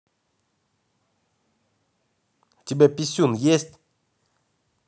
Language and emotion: Russian, angry